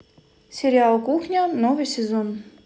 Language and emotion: Russian, neutral